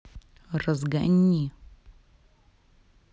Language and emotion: Russian, angry